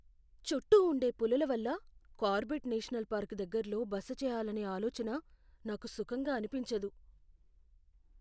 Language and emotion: Telugu, fearful